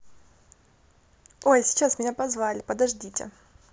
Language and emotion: Russian, positive